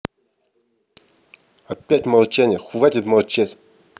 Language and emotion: Russian, angry